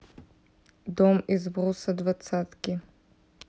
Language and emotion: Russian, neutral